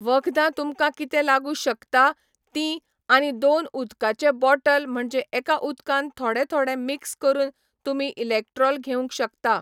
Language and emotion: Goan Konkani, neutral